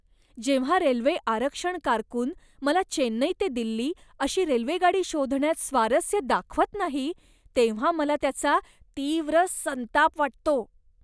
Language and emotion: Marathi, disgusted